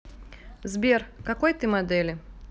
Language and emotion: Russian, neutral